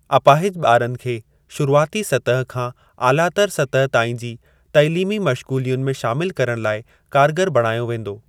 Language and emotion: Sindhi, neutral